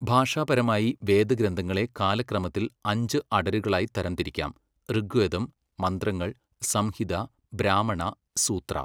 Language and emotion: Malayalam, neutral